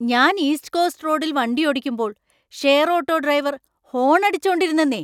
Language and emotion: Malayalam, angry